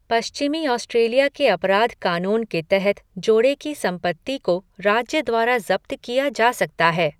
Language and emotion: Hindi, neutral